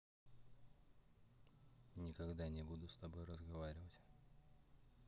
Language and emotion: Russian, neutral